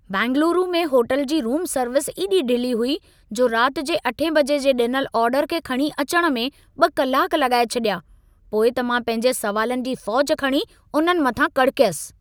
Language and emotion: Sindhi, angry